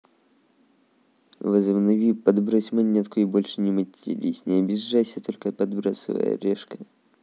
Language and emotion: Russian, neutral